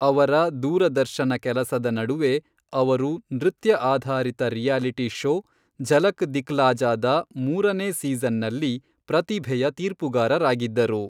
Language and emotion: Kannada, neutral